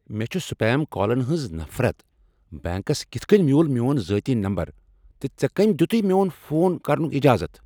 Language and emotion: Kashmiri, angry